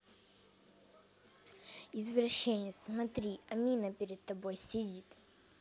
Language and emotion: Russian, neutral